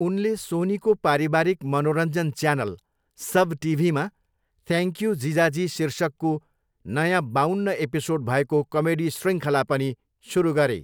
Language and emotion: Nepali, neutral